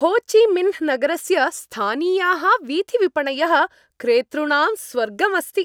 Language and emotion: Sanskrit, happy